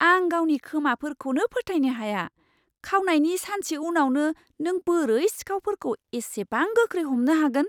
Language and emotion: Bodo, surprised